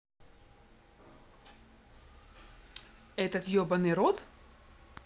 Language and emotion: Russian, angry